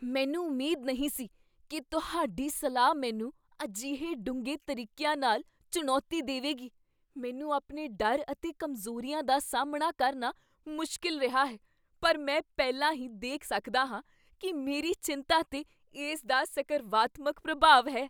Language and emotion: Punjabi, surprised